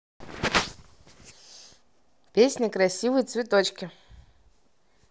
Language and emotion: Russian, positive